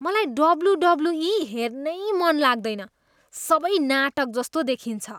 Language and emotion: Nepali, disgusted